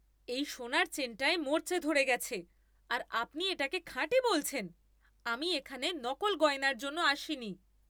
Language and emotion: Bengali, angry